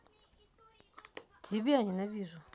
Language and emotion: Russian, neutral